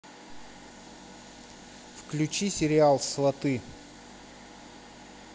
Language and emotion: Russian, neutral